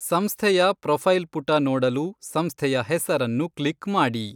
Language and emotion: Kannada, neutral